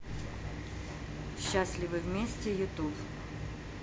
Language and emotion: Russian, neutral